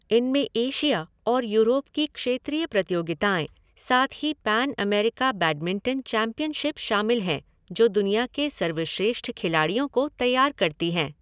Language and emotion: Hindi, neutral